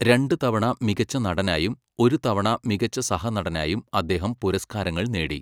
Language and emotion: Malayalam, neutral